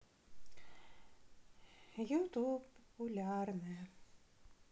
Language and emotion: Russian, sad